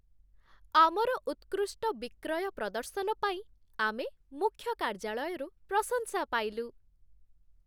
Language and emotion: Odia, happy